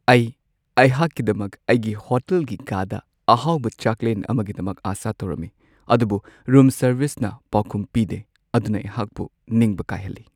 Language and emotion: Manipuri, sad